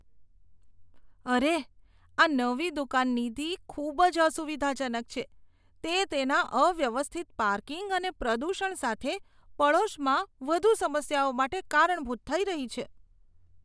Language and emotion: Gujarati, disgusted